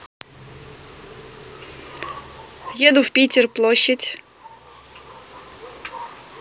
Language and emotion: Russian, neutral